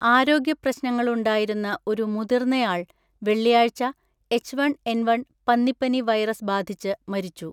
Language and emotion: Malayalam, neutral